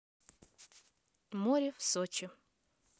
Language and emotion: Russian, neutral